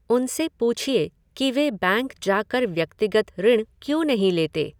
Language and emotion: Hindi, neutral